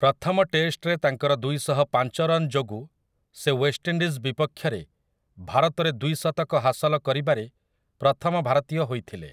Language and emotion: Odia, neutral